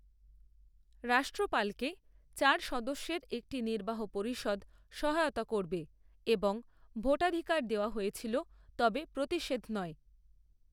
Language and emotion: Bengali, neutral